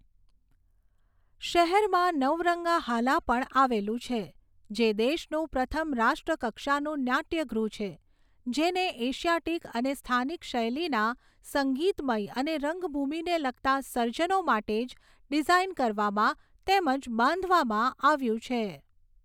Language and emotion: Gujarati, neutral